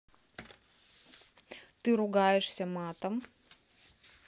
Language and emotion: Russian, neutral